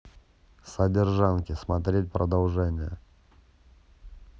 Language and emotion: Russian, neutral